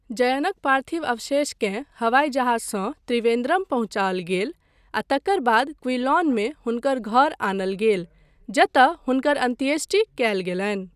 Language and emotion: Maithili, neutral